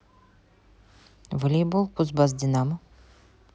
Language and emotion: Russian, neutral